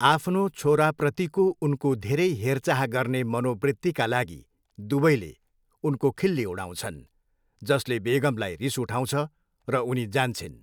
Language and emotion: Nepali, neutral